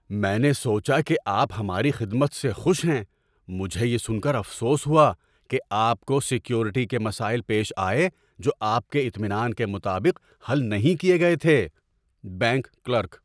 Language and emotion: Urdu, surprised